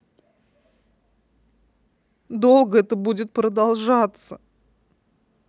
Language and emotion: Russian, sad